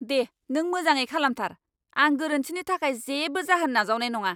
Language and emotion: Bodo, angry